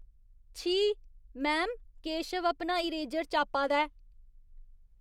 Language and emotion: Dogri, disgusted